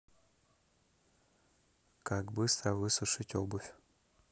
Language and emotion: Russian, neutral